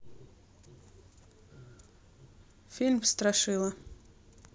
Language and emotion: Russian, neutral